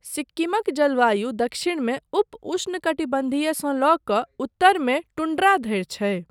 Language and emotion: Maithili, neutral